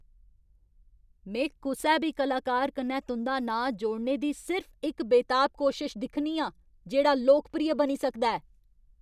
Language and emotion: Dogri, angry